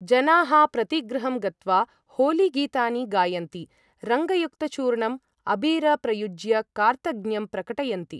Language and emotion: Sanskrit, neutral